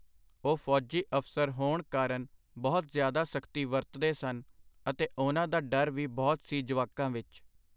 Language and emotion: Punjabi, neutral